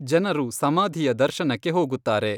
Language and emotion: Kannada, neutral